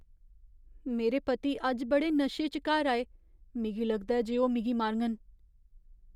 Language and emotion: Dogri, fearful